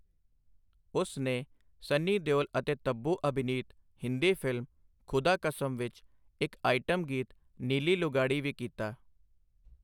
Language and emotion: Punjabi, neutral